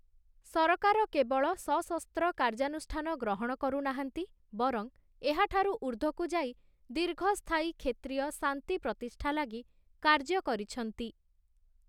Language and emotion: Odia, neutral